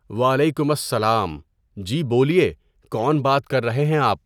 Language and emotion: Urdu, neutral